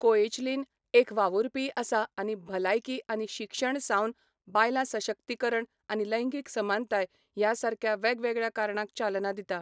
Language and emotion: Goan Konkani, neutral